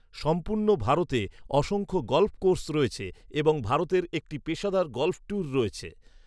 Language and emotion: Bengali, neutral